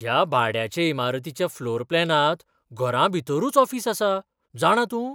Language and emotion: Goan Konkani, surprised